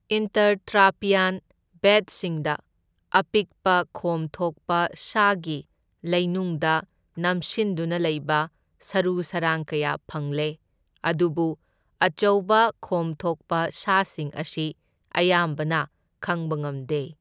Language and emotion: Manipuri, neutral